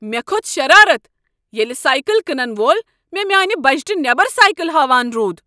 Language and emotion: Kashmiri, angry